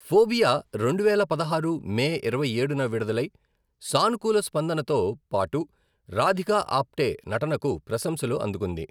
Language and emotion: Telugu, neutral